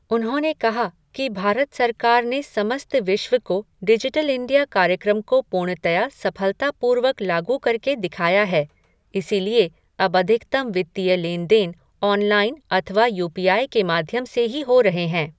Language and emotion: Hindi, neutral